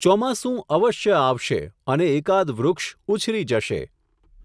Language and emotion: Gujarati, neutral